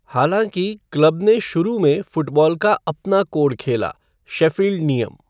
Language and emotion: Hindi, neutral